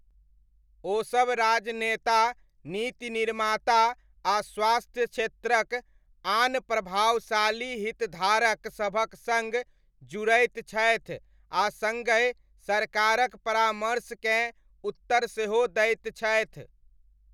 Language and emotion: Maithili, neutral